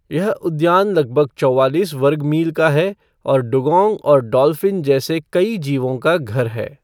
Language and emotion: Hindi, neutral